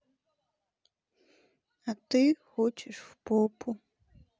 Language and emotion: Russian, sad